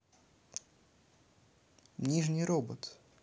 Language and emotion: Russian, neutral